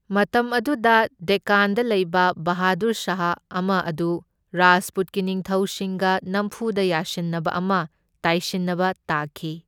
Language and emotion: Manipuri, neutral